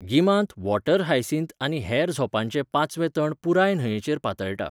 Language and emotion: Goan Konkani, neutral